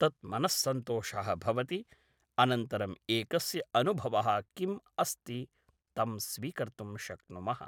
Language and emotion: Sanskrit, neutral